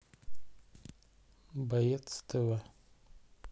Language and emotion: Russian, neutral